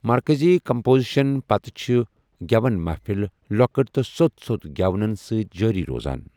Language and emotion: Kashmiri, neutral